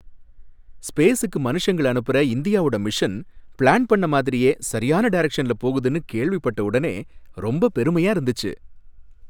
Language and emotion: Tamil, happy